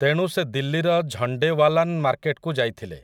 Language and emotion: Odia, neutral